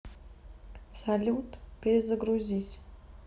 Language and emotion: Russian, neutral